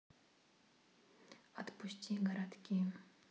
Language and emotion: Russian, neutral